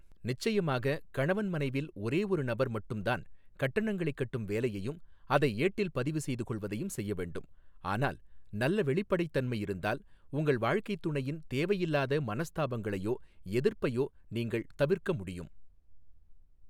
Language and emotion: Tamil, neutral